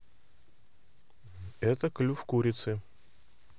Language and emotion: Russian, neutral